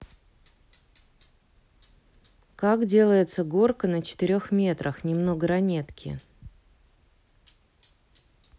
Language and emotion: Russian, neutral